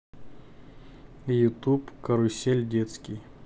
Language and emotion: Russian, neutral